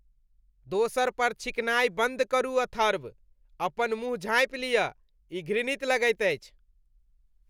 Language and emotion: Maithili, disgusted